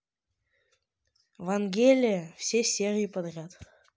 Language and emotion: Russian, neutral